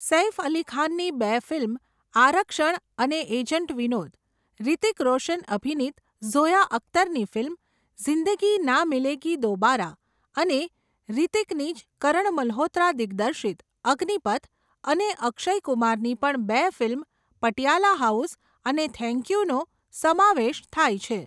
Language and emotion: Gujarati, neutral